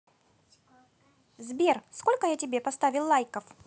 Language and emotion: Russian, positive